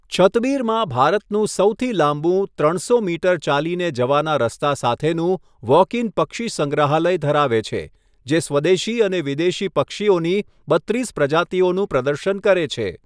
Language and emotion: Gujarati, neutral